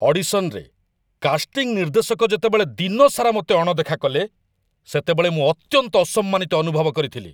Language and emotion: Odia, angry